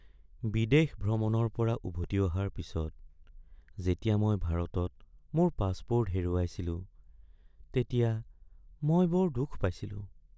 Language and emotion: Assamese, sad